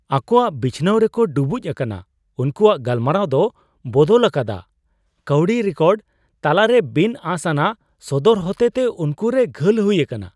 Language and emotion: Santali, surprised